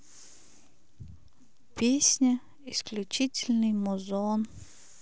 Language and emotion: Russian, sad